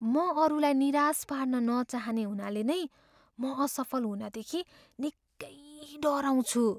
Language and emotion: Nepali, fearful